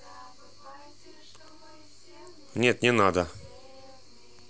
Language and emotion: Russian, neutral